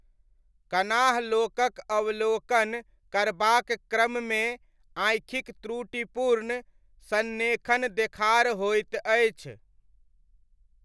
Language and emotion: Maithili, neutral